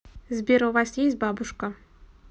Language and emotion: Russian, neutral